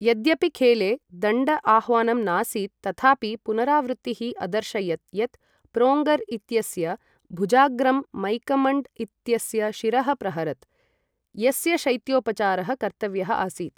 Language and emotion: Sanskrit, neutral